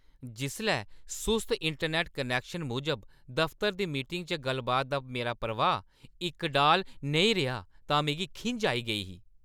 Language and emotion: Dogri, angry